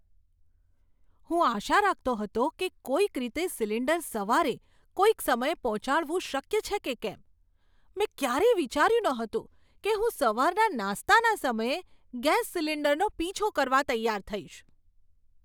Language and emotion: Gujarati, surprised